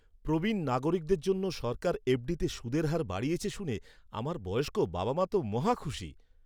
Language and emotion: Bengali, happy